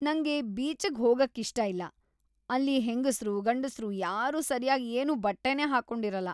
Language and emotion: Kannada, disgusted